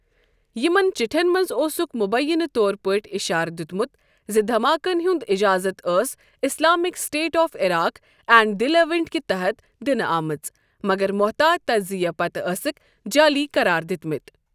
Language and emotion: Kashmiri, neutral